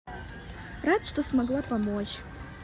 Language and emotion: Russian, positive